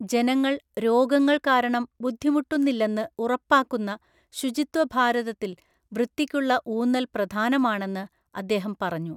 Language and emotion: Malayalam, neutral